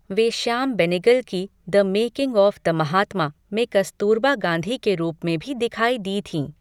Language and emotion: Hindi, neutral